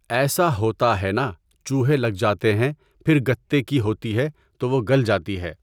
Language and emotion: Urdu, neutral